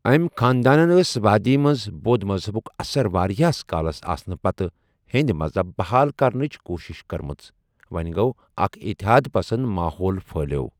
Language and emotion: Kashmiri, neutral